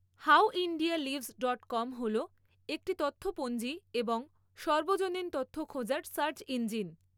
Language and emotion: Bengali, neutral